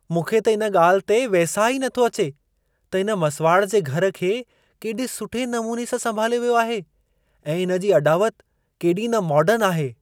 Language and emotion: Sindhi, surprised